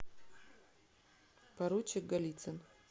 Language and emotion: Russian, neutral